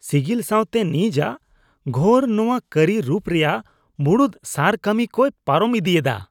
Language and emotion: Santali, disgusted